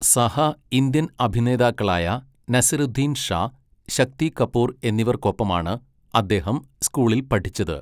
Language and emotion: Malayalam, neutral